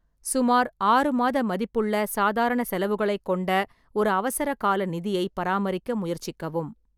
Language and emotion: Tamil, neutral